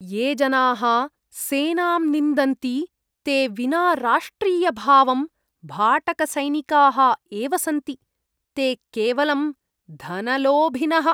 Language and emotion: Sanskrit, disgusted